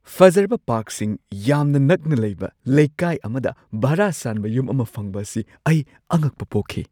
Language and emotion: Manipuri, surprised